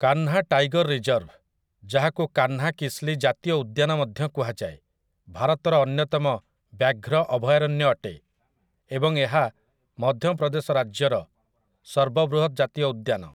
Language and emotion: Odia, neutral